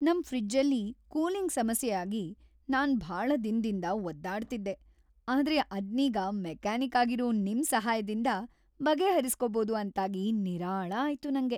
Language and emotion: Kannada, happy